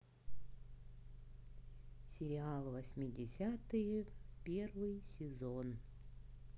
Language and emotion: Russian, neutral